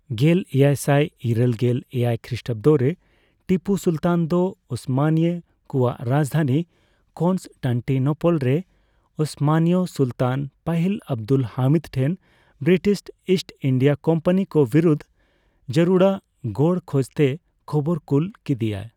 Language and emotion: Santali, neutral